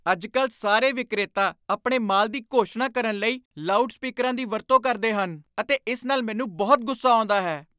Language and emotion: Punjabi, angry